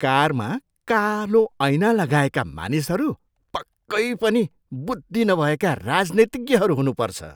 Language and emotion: Nepali, disgusted